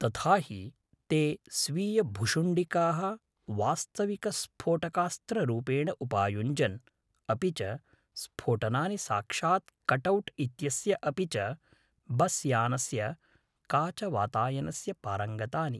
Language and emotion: Sanskrit, neutral